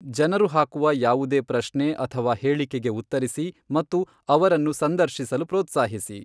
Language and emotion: Kannada, neutral